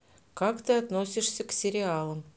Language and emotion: Russian, neutral